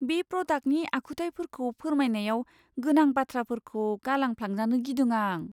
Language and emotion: Bodo, fearful